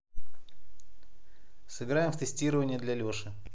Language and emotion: Russian, neutral